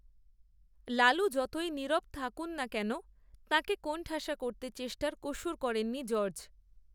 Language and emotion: Bengali, neutral